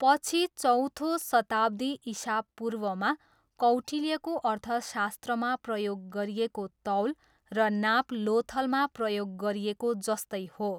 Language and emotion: Nepali, neutral